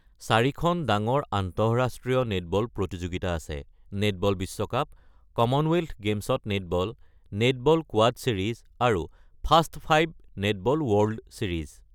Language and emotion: Assamese, neutral